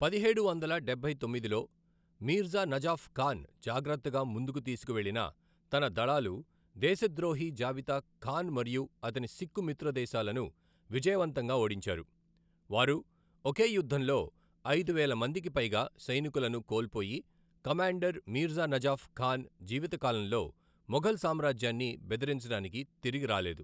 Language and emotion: Telugu, neutral